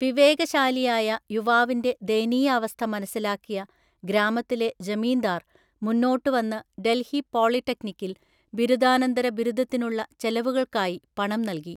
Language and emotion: Malayalam, neutral